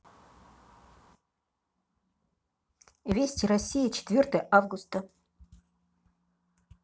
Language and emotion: Russian, neutral